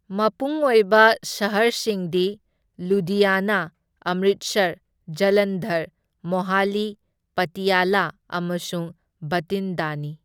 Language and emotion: Manipuri, neutral